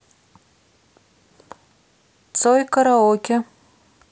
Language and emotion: Russian, neutral